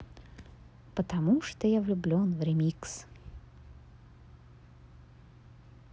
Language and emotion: Russian, positive